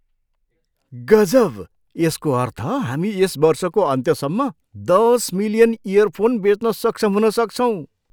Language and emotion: Nepali, surprised